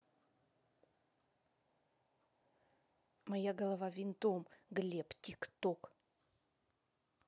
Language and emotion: Russian, angry